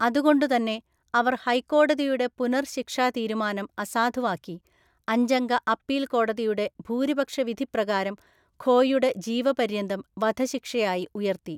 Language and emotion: Malayalam, neutral